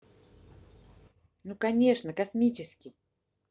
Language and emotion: Russian, positive